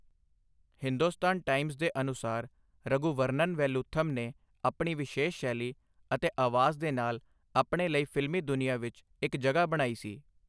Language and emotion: Punjabi, neutral